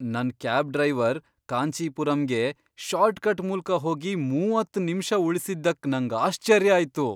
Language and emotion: Kannada, surprised